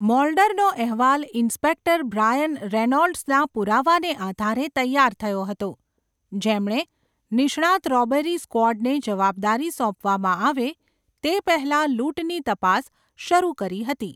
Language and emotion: Gujarati, neutral